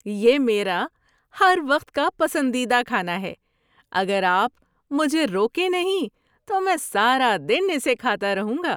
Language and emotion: Urdu, happy